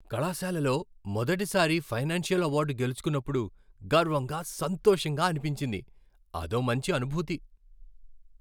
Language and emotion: Telugu, happy